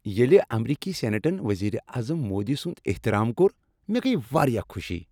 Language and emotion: Kashmiri, happy